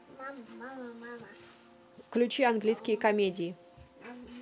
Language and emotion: Russian, neutral